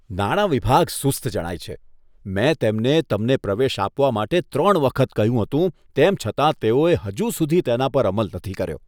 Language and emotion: Gujarati, disgusted